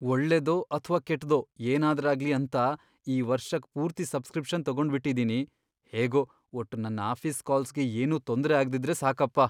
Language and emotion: Kannada, fearful